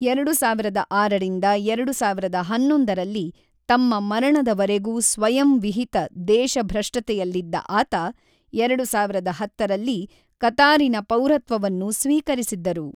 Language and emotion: Kannada, neutral